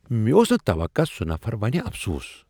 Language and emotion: Kashmiri, surprised